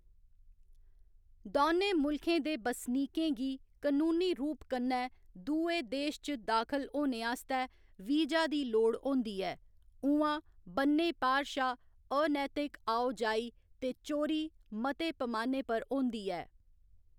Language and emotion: Dogri, neutral